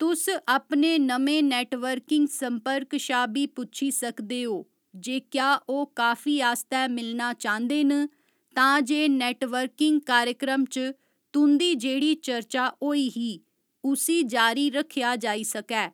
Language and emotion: Dogri, neutral